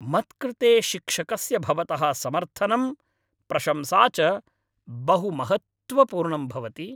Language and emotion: Sanskrit, happy